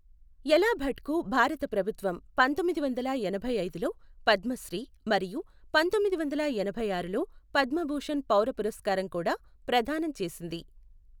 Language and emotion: Telugu, neutral